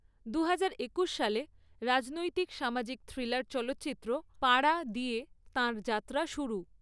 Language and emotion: Bengali, neutral